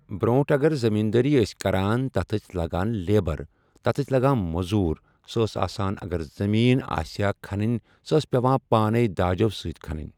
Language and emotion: Kashmiri, neutral